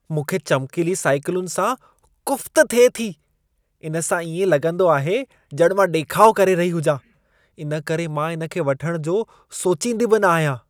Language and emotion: Sindhi, disgusted